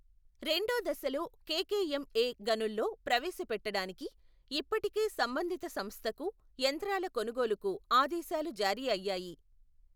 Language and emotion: Telugu, neutral